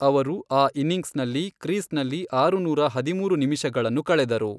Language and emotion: Kannada, neutral